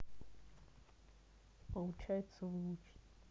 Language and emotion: Russian, neutral